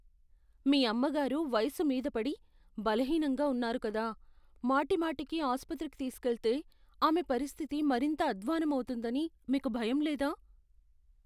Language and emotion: Telugu, fearful